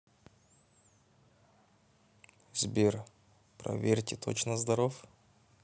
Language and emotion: Russian, neutral